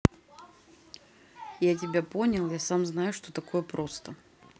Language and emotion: Russian, neutral